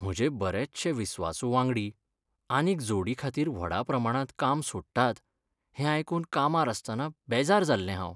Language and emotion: Goan Konkani, sad